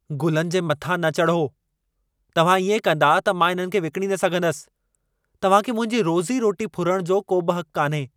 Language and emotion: Sindhi, angry